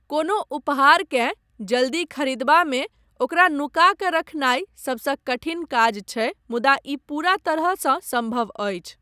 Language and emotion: Maithili, neutral